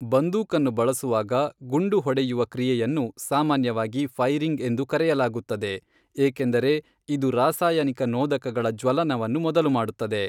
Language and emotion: Kannada, neutral